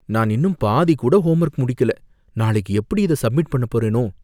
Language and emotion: Tamil, fearful